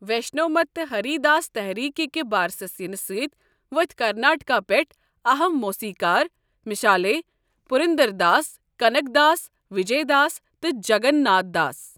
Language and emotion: Kashmiri, neutral